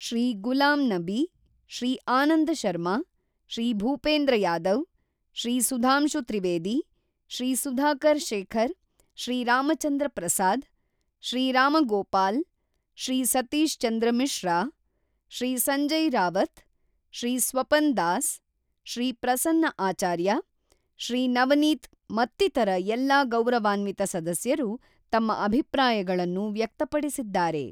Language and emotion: Kannada, neutral